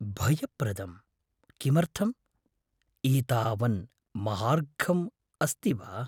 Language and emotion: Sanskrit, fearful